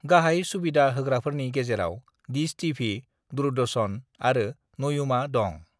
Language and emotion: Bodo, neutral